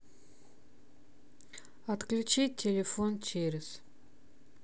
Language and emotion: Russian, neutral